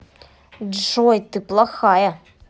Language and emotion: Russian, angry